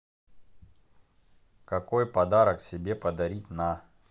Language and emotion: Russian, neutral